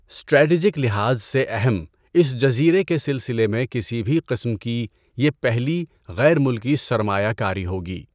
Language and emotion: Urdu, neutral